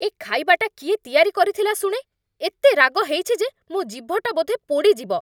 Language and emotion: Odia, angry